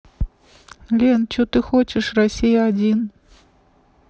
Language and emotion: Russian, neutral